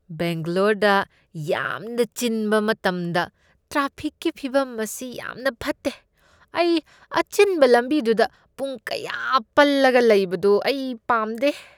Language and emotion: Manipuri, disgusted